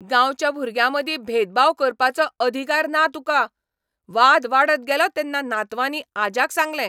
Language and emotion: Goan Konkani, angry